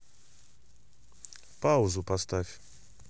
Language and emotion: Russian, neutral